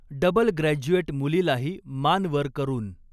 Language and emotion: Marathi, neutral